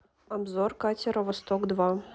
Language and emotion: Russian, neutral